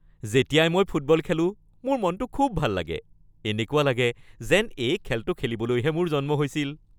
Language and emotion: Assamese, happy